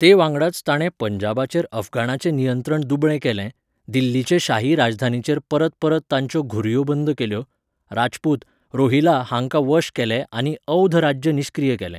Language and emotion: Goan Konkani, neutral